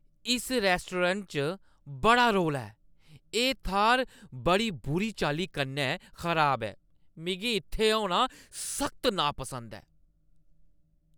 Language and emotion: Dogri, angry